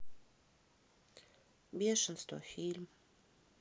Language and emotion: Russian, sad